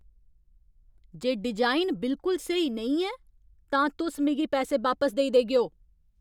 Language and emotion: Dogri, angry